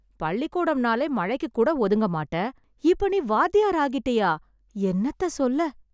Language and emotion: Tamil, surprised